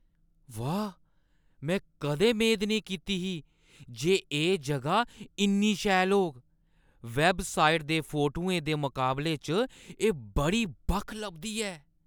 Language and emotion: Dogri, surprised